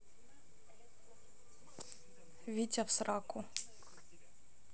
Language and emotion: Russian, neutral